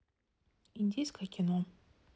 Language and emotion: Russian, neutral